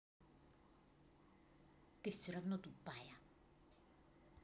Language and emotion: Russian, angry